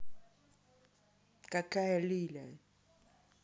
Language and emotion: Russian, angry